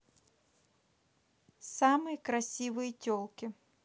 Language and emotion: Russian, neutral